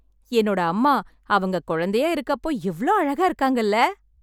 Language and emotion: Tamil, happy